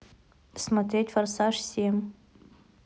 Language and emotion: Russian, neutral